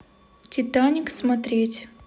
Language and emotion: Russian, neutral